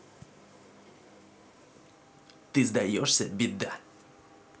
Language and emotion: Russian, angry